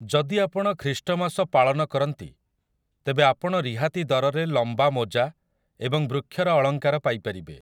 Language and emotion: Odia, neutral